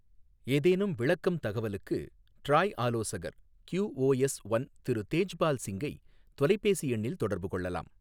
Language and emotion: Tamil, neutral